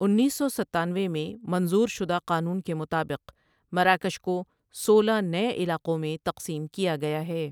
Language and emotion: Urdu, neutral